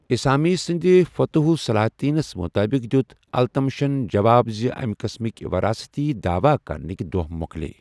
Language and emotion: Kashmiri, neutral